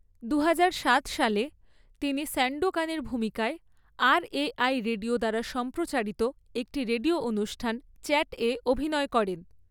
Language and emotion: Bengali, neutral